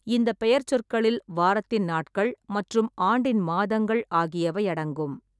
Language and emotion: Tamil, neutral